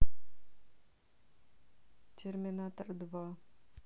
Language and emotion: Russian, neutral